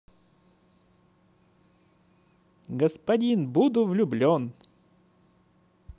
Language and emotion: Russian, positive